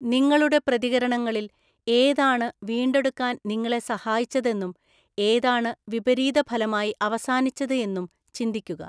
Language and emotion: Malayalam, neutral